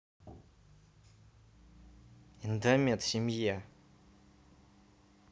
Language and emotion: Russian, angry